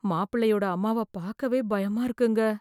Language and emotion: Tamil, fearful